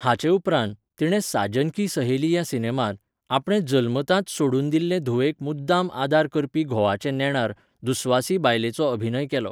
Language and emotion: Goan Konkani, neutral